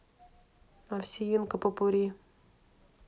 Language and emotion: Russian, neutral